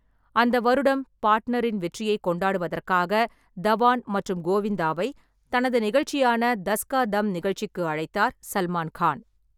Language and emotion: Tamil, neutral